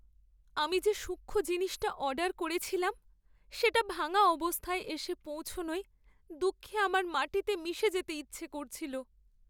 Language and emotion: Bengali, sad